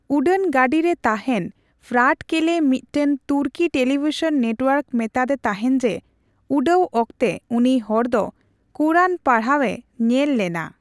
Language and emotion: Santali, neutral